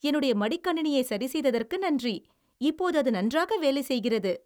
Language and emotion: Tamil, happy